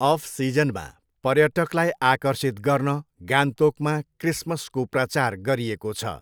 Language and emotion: Nepali, neutral